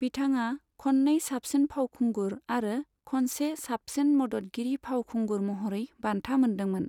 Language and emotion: Bodo, neutral